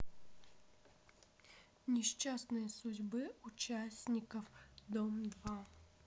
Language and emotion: Russian, neutral